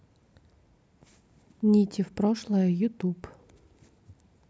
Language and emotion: Russian, neutral